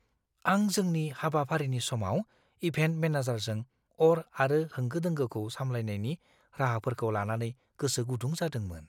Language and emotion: Bodo, fearful